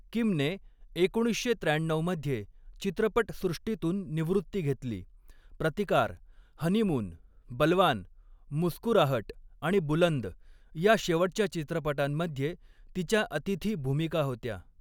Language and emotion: Marathi, neutral